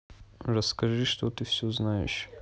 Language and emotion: Russian, neutral